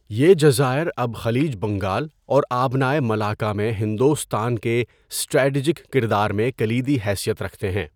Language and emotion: Urdu, neutral